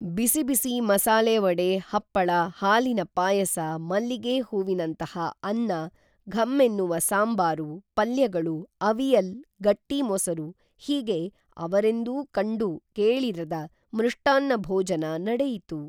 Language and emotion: Kannada, neutral